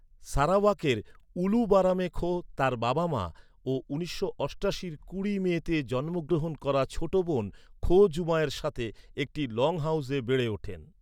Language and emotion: Bengali, neutral